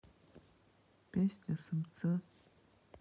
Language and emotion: Russian, sad